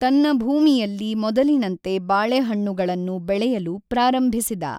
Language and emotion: Kannada, neutral